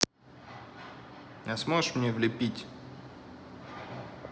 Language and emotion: Russian, neutral